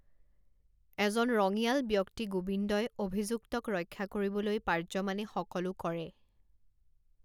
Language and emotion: Assamese, neutral